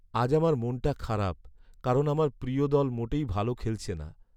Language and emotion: Bengali, sad